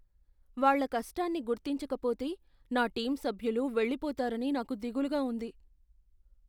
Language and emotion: Telugu, fearful